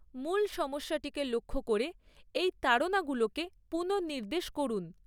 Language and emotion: Bengali, neutral